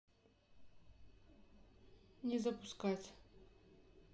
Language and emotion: Russian, neutral